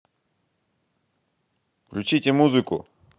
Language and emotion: Russian, angry